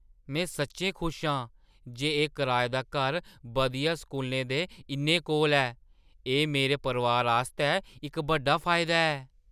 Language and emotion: Dogri, surprised